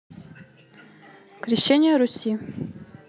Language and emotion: Russian, neutral